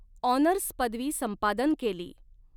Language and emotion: Marathi, neutral